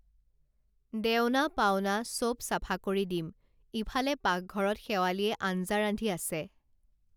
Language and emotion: Assamese, neutral